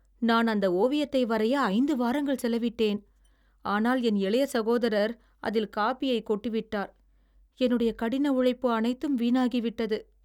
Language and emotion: Tamil, sad